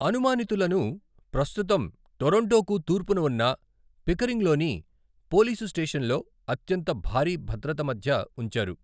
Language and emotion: Telugu, neutral